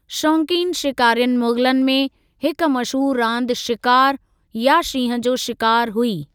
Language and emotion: Sindhi, neutral